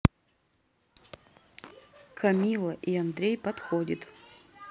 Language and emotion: Russian, neutral